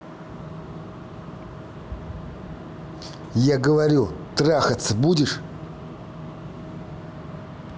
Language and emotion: Russian, angry